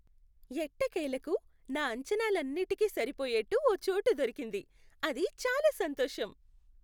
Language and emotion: Telugu, happy